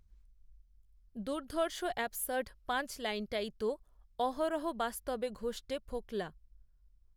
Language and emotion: Bengali, neutral